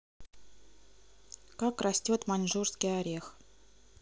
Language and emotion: Russian, neutral